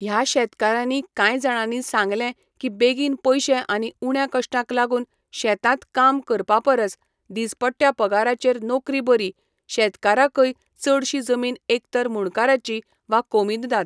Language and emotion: Goan Konkani, neutral